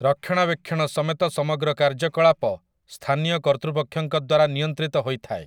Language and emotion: Odia, neutral